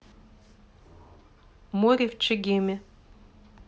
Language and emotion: Russian, neutral